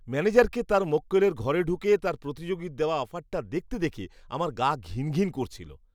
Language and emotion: Bengali, disgusted